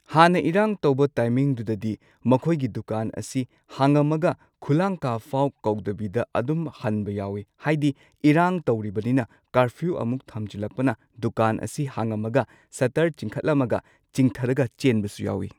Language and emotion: Manipuri, neutral